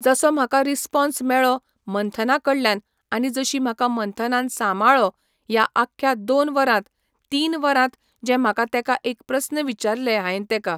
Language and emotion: Goan Konkani, neutral